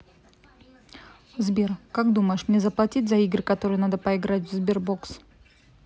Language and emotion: Russian, neutral